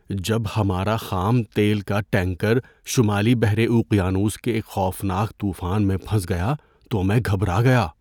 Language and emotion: Urdu, fearful